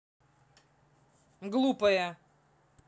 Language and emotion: Russian, angry